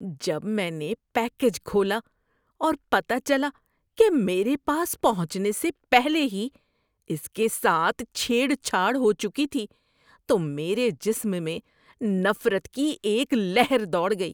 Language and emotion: Urdu, disgusted